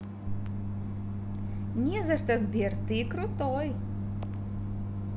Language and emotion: Russian, positive